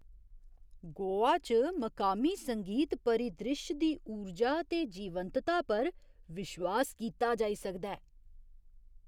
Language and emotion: Dogri, surprised